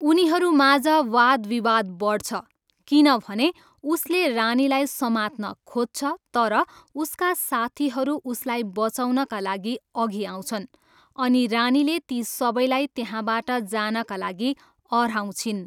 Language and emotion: Nepali, neutral